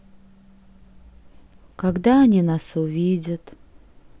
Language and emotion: Russian, sad